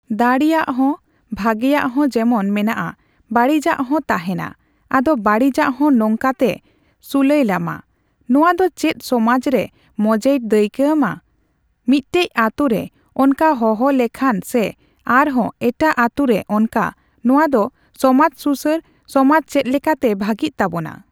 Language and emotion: Santali, neutral